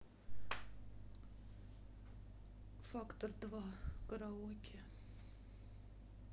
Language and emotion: Russian, sad